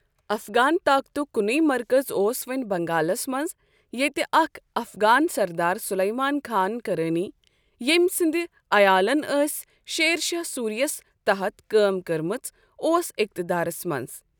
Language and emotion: Kashmiri, neutral